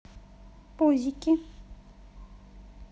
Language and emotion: Russian, positive